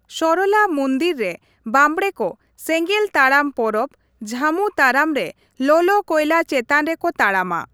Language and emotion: Santali, neutral